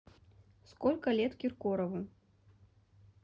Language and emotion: Russian, neutral